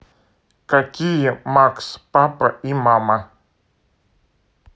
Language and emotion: Russian, neutral